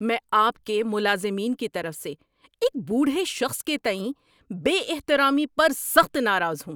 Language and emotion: Urdu, angry